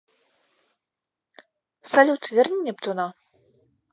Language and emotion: Russian, neutral